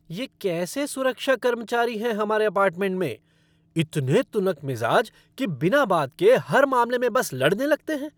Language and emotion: Hindi, angry